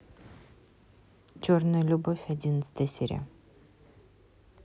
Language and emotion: Russian, neutral